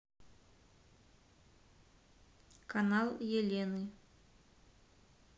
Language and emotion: Russian, neutral